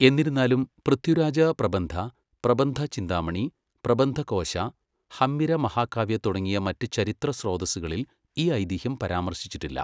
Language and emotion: Malayalam, neutral